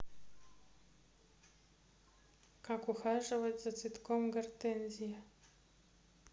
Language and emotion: Russian, neutral